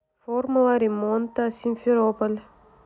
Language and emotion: Russian, neutral